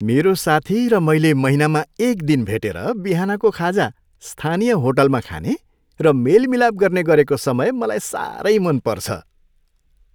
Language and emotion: Nepali, happy